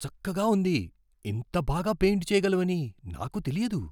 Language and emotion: Telugu, surprised